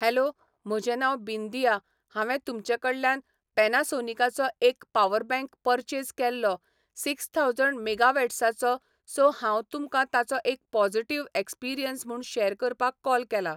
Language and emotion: Goan Konkani, neutral